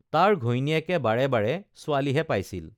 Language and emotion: Assamese, neutral